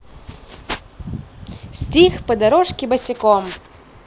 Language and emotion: Russian, positive